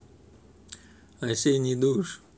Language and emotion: Russian, neutral